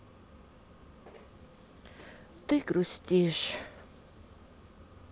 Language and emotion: Russian, sad